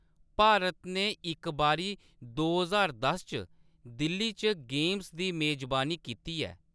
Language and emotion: Dogri, neutral